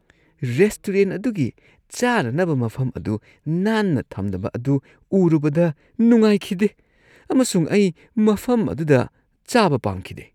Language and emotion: Manipuri, disgusted